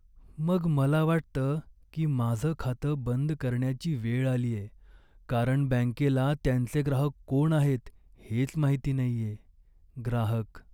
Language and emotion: Marathi, sad